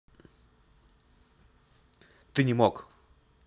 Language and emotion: Russian, neutral